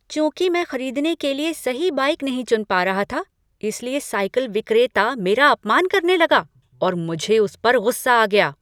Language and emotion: Hindi, angry